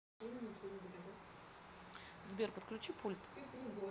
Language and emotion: Russian, neutral